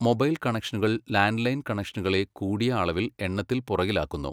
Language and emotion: Malayalam, neutral